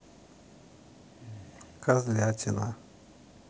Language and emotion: Russian, neutral